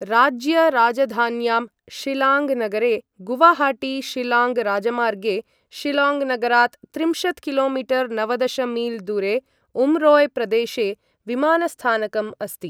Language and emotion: Sanskrit, neutral